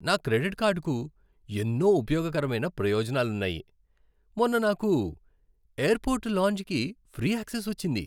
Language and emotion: Telugu, happy